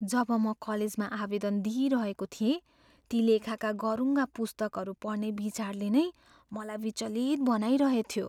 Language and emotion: Nepali, fearful